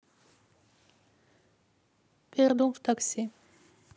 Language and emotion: Russian, neutral